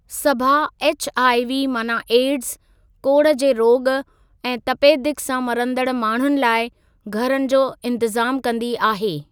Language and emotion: Sindhi, neutral